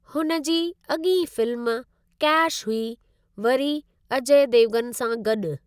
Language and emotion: Sindhi, neutral